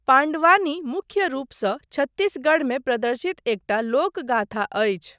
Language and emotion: Maithili, neutral